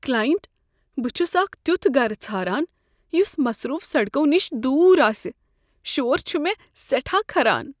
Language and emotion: Kashmiri, fearful